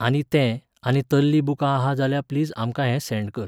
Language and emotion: Goan Konkani, neutral